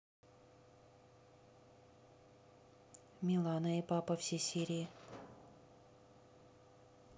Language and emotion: Russian, neutral